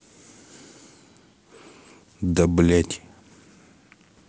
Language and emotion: Russian, angry